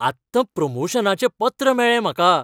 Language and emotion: Goan Konkani, happy